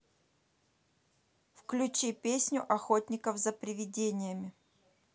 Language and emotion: Russian, neutral